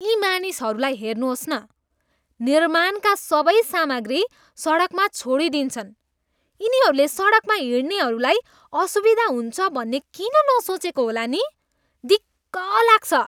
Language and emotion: Nepali, disgusted